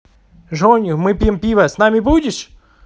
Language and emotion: Russian, positive